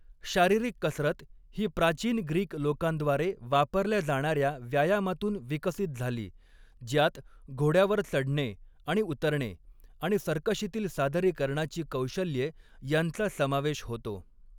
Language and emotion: Marathi, neutral